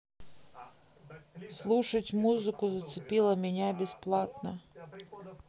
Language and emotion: Russian, neutral